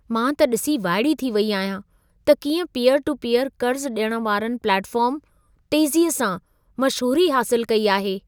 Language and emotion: Sindhi, surprised